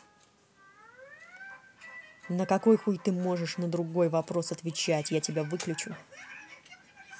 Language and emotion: Russian, angry